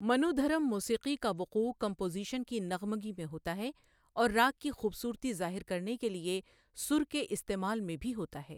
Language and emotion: Urdu, neutral